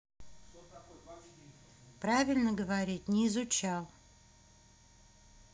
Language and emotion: Russian, angry